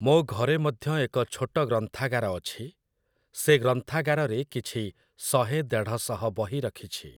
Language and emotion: Odia, neutral